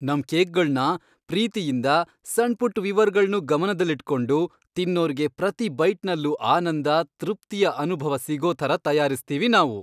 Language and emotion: Kannada, happy